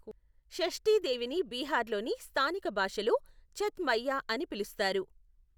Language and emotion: Telugu, neutral